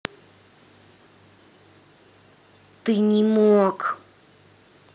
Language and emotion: Russian, angry